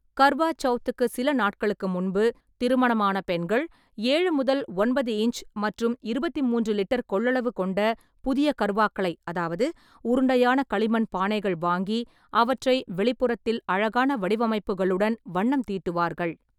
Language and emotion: Tamil, neutral